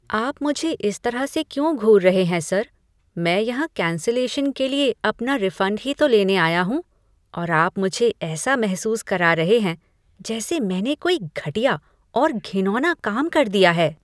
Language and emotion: Hindi, disgusted